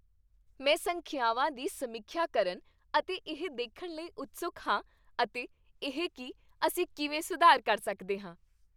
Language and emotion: Punjabi, happy